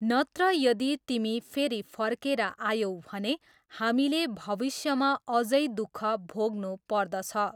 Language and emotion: Nepali, neutral